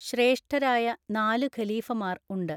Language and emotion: Malayalam, neutral